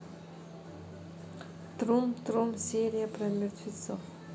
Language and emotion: Russian, neutral